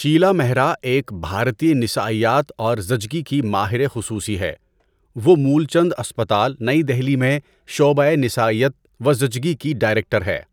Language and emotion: Urdu, neutral